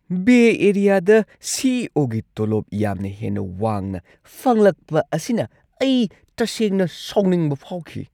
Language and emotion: Manipuri, angry